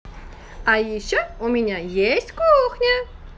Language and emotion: Russian, positive